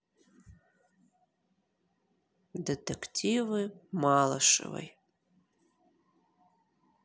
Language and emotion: Russian, sad